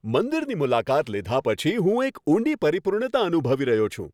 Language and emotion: Gujarati, happy